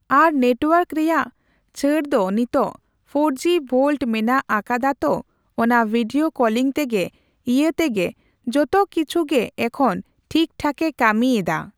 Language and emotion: Santali, neutral